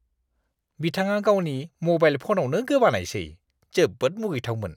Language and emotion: Bodo, disgusted